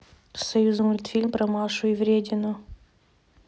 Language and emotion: Russian, neutral